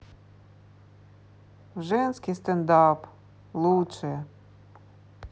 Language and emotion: Russian, sad